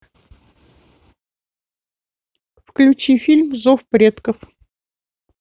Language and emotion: Russian, neutral